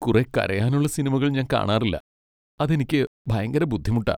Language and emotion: Malayalam, sad